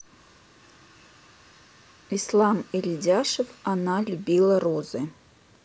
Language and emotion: Russian, neutral